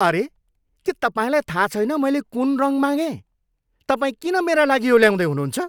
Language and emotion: Nepali, angry